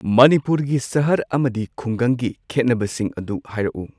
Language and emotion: Manipuri, neutral